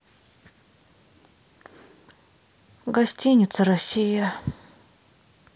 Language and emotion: Russian, sad